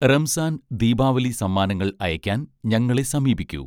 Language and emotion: Malayalam, neutral